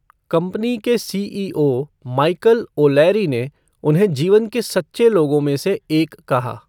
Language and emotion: Hindi, neutral